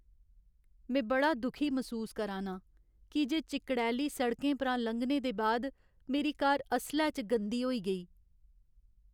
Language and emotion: Dogri, sad